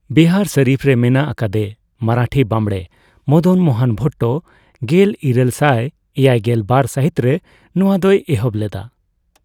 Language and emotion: Santali, neutral